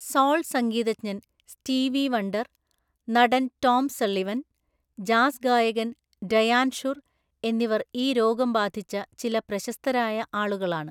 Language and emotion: Malayalam, neutral